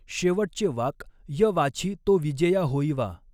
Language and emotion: Marathi, neutral